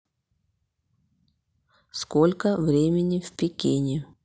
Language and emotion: Russian, neutral